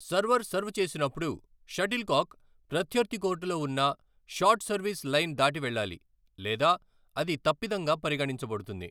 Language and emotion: Telugu, neutral